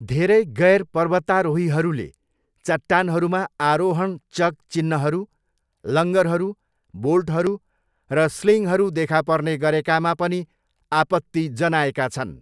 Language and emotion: Nepali, neutral